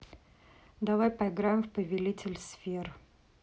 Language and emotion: Russian, neutral